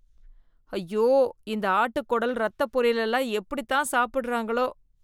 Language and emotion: Tamil, disgusted